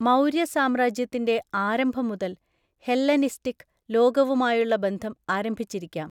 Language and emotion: Malayalam, neutral